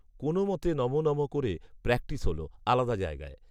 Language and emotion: Bengali, neutral